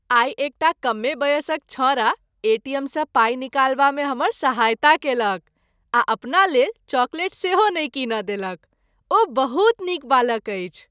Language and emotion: Maithili, happy